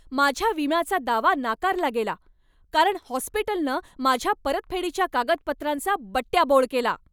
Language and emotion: Marathi, angry